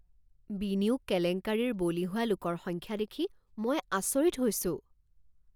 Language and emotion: Assamese, surprised